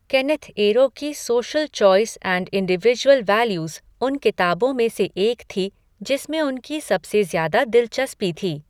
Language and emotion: Hindi, neutral